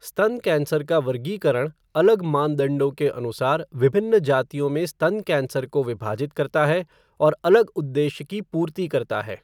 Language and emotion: Hindi, neutral